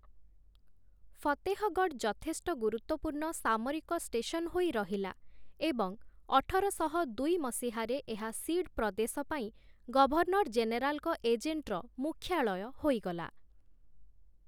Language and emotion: Odia, neutral